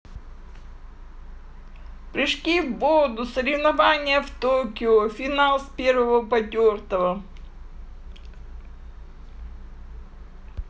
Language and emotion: Russian, positive